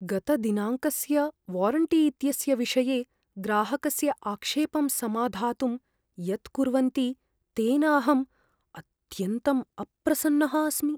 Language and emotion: Sanskrit, fearful